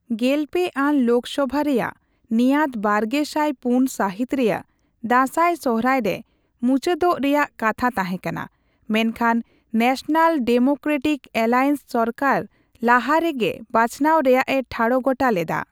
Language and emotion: Santali, neutral